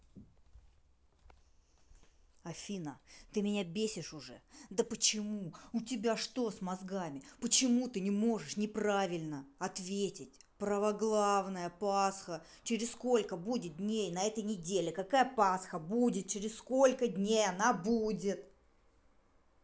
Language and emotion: Russian, angry